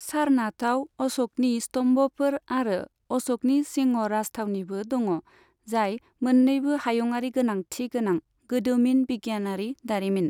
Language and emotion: Bodo, neutral